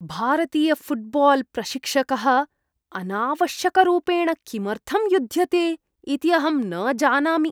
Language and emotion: Sanskrit, disgusted